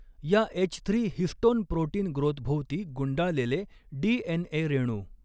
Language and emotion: Marathi, neutral